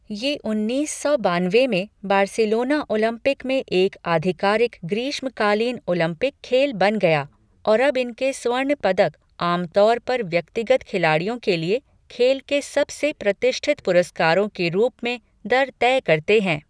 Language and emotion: Hindi, neutral